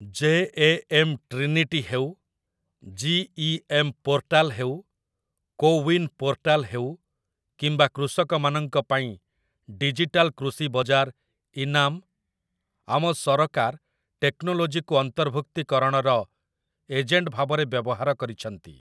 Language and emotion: Odia, neutral